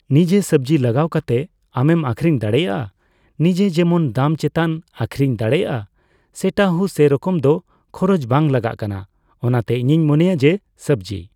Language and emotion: Santali, neutral